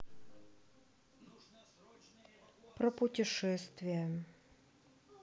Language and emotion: Russian, sad